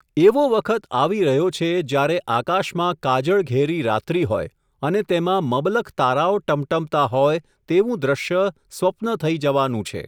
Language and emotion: Gujarati, neutral